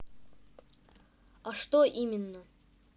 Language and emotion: Russian, neutral